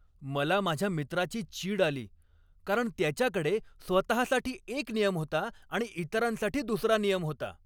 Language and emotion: Marathi, angry